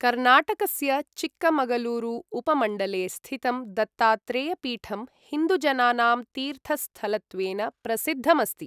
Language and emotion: Sanskrit, neutral